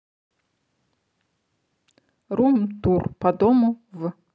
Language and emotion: Russian, neutral